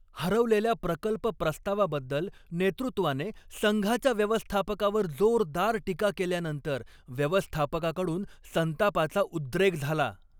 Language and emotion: Marathi, angry